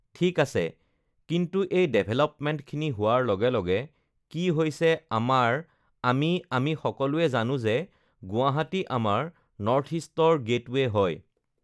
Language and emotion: Assamese, neutral